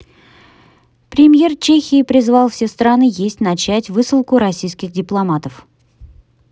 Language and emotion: Russian, neutral